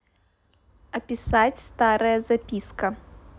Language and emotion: Russian, neutral